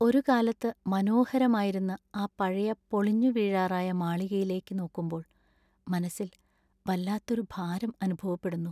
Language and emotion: Malayalam, sad